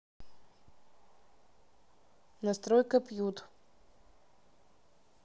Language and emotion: Russian, neutral